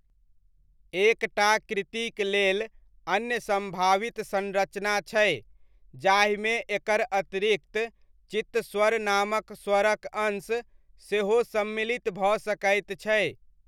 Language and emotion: Maithili, neutral